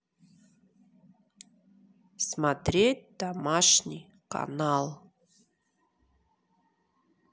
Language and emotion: Russian, neutral